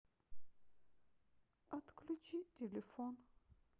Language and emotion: Russian, sad